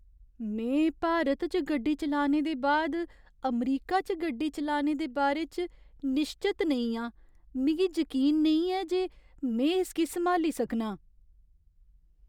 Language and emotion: Dogri, fearful